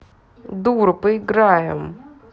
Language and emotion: Russian, angry